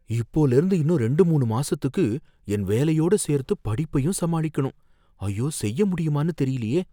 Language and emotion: Tamil, fearful